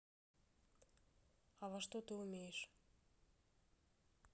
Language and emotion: Russian, neutral